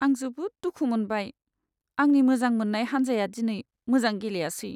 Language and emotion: Bodo, sad